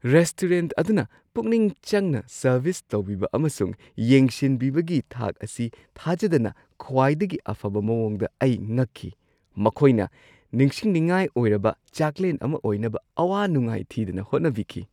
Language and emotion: Manipuri, surprised